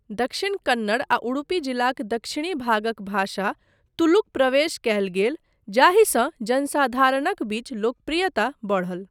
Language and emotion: Maithili, neutral